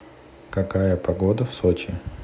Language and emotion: Russian, neutral